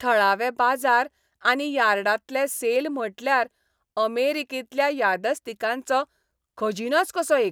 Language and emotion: Goan Konkani, happy